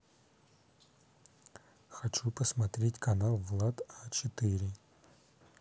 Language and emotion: Russian, neutral